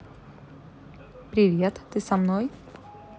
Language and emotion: Russian, neutral